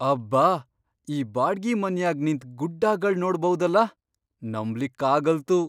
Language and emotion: Kannada, surprised